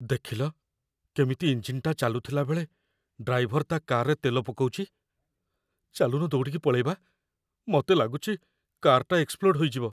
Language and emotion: Odia, fearful